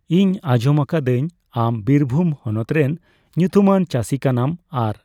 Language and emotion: Santali, neutral